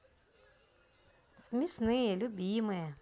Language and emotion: Russian, positive